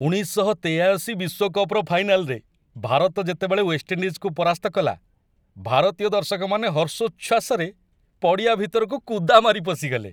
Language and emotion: Odia, happy